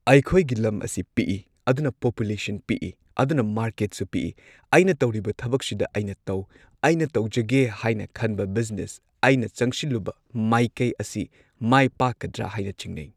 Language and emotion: Manipuri, neutral